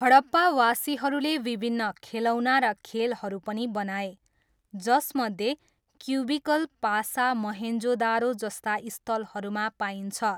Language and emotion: Nepali, neutral